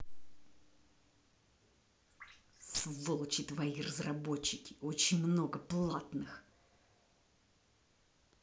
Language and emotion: Russian, angry